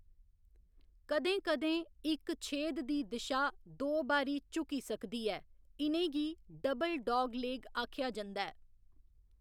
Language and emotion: Dogri, neutral